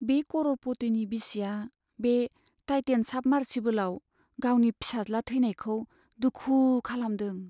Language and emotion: Bodo, sad